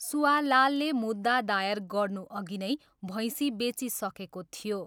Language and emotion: Nepali, neutral